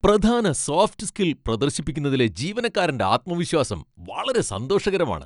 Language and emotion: Malayalam, happy